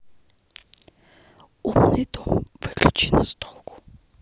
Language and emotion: Russian, neutral